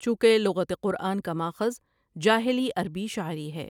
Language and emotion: Urdu, neutral